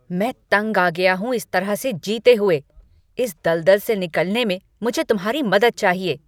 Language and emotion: Hindi, angry